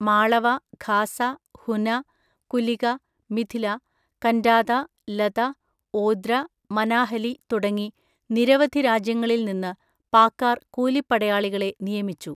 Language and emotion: Malayalam, neutral